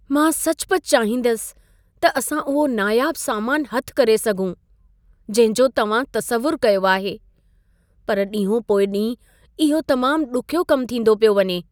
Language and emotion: Sindhi, sad